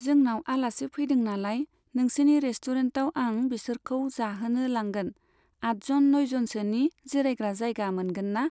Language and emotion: Bodo, neutral